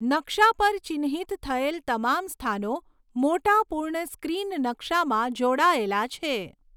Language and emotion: Gujarati, neutral